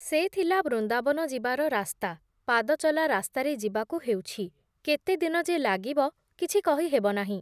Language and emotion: Odia, neutral